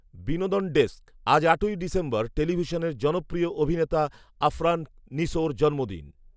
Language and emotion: Bengali, neutral